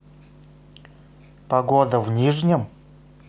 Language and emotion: Russian, neutral